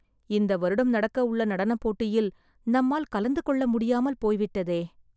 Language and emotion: Tamil, sad